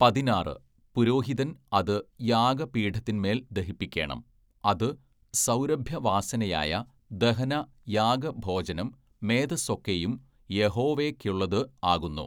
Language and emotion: Malayalam, neutral